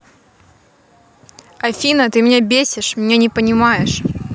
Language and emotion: Russian, angry